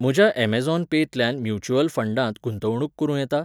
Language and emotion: Goan Konkani, neutral